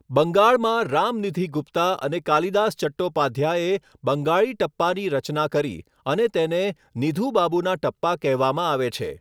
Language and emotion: Gujarati, neutral